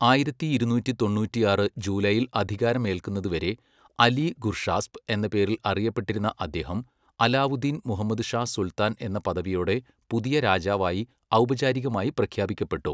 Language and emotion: Malayalam, neutral